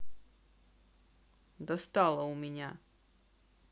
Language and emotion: Russian, angry